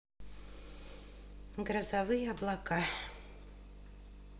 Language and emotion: Russian, sad